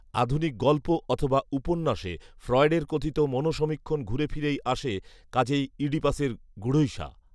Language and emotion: Bengali, neutral